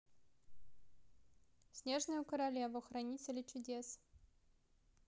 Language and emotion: Russian, neutral